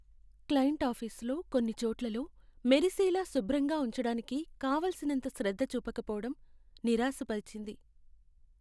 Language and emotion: Telugu, sad